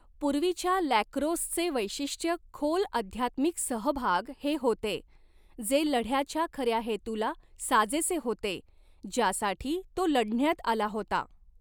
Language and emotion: Marathi, neutral